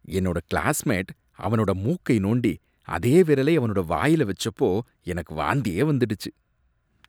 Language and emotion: Tamil, disgusted